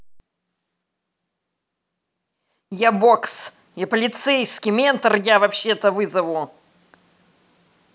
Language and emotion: Russian, angry